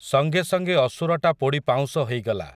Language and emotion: Odia, neutral